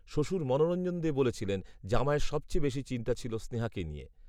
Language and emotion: Bengali, neutral